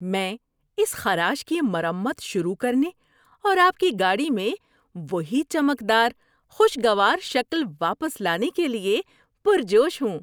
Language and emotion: Urdu, happy